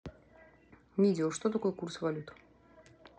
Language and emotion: Russian, neutral